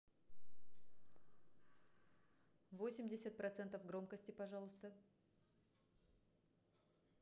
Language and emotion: Russian, neutral